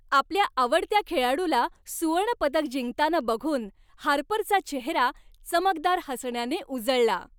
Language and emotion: Marathi, happy